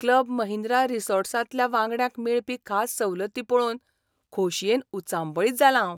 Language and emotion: Goan Konkani, surprised